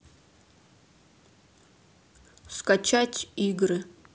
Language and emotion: Russian, neutral